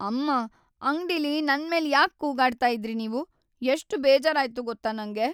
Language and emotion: Kannada, sad